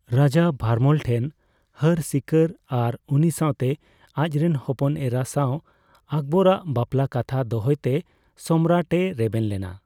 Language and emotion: Santali, neutral